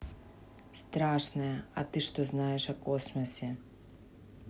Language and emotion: Russian, neutral